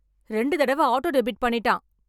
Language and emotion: Tamil, angry